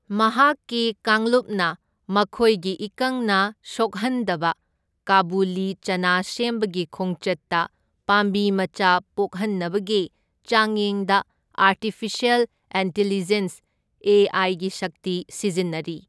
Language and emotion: Manipuri, neutral